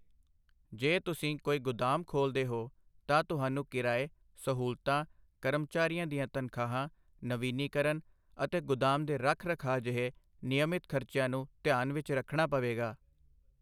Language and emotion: Punjabi, neutral